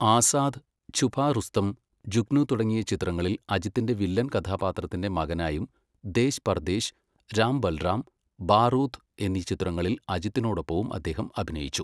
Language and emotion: Malayalam, neutral